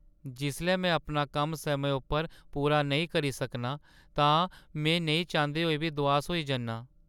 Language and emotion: Dogri, sad